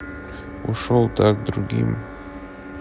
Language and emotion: Russian, neutral